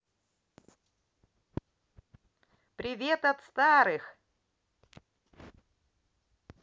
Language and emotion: Russian, positive